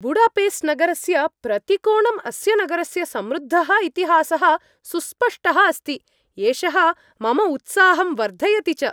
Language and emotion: Sanskrit, happy